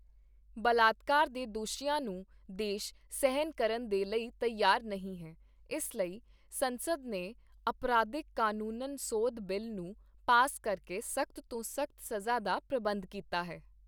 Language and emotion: Punjabi, neutral